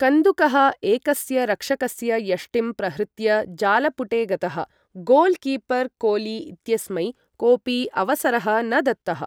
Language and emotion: Sanskrit, neutral